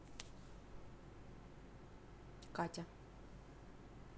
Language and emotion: Russian, neutral